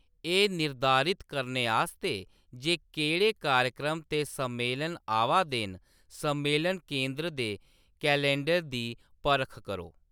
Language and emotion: Dogri, neutral